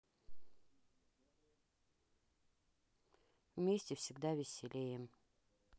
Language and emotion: Russian, neutral